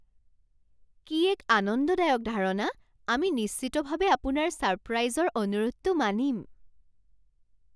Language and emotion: Assamese, surprised